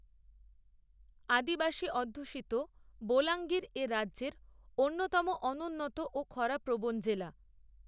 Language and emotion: Bengali, neutral